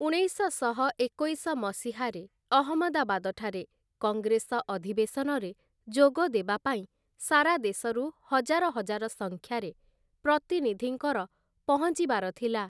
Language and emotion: Odia, neutral